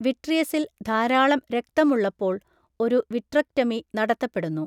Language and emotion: Malayalam, neutral